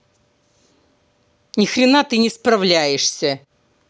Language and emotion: Russian, angry